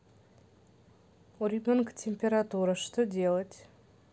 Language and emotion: Russian, neutral